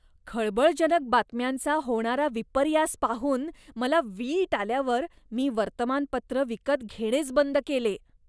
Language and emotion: Marathi, disgusted